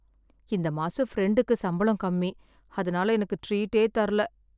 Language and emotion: Tamil, sad